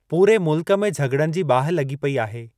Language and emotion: Sindhi, neutral